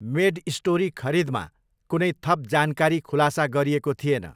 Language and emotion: Nepali, neutral